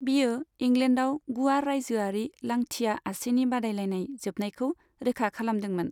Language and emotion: Bodo, neutral